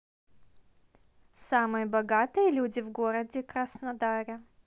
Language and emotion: Russian, neutral